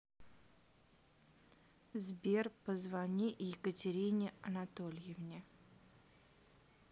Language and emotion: Russian, neutral